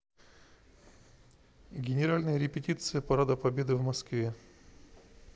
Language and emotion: Russian, neutral